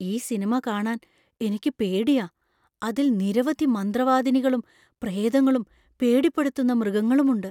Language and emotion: Malayalam, fearful